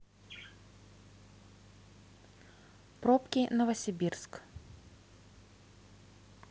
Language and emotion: Russian, neutral